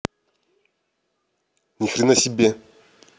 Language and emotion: Russian, angry